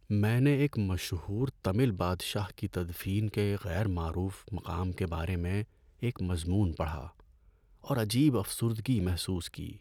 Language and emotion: Urdu, sad